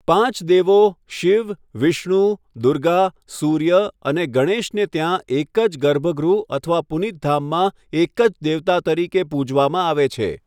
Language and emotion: Gujarati, neutral